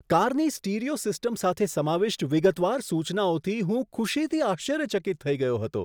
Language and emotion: Gujarati, surprised